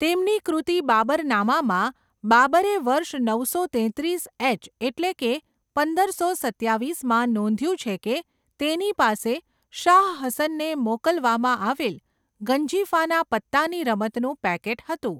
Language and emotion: Gujarati, neutral